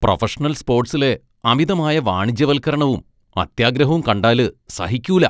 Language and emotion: Malayalam, disgusted